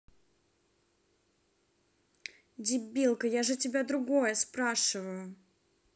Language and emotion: Russian, angry